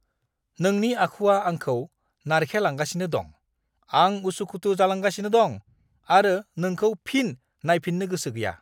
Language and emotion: Bodo, angry